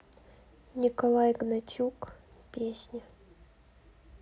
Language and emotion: Russian, sad